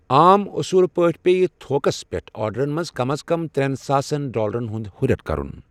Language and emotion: Kashmiri, neutral